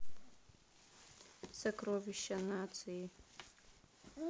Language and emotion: Russian, neutral